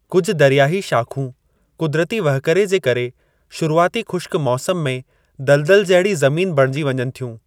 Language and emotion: Sindhi, neutral